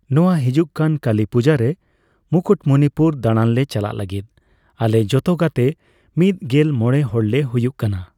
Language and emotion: Santali, neutral